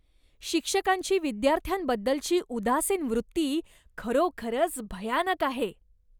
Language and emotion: Marathi, disgusted